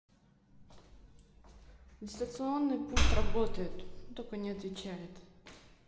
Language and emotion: Russian, neutral